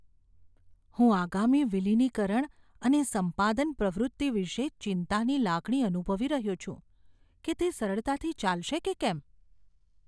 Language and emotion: Gujarati, fearful